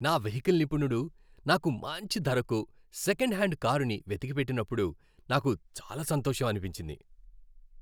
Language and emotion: Telugu, happy